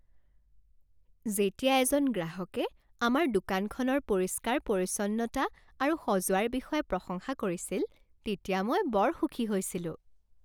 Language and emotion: Assamese, happy